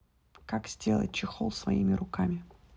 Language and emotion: Russian, neutral